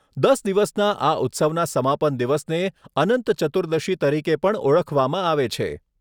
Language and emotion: Gujarati, neutral